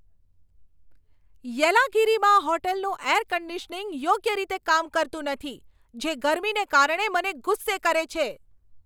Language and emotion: Gujarati, angry